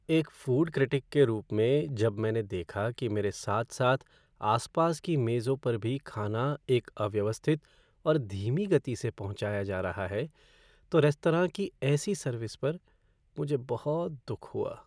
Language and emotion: Hindi, sad